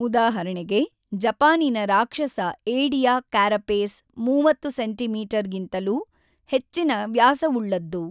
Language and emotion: Kannada, neutral